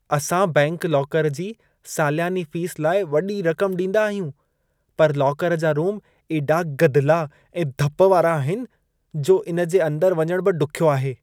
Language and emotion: Sindhi, disgusted